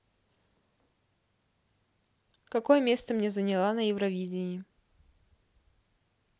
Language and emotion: Russian, neutral